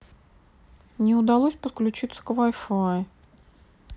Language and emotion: Russian, sad